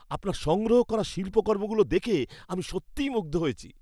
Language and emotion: Bengali, happy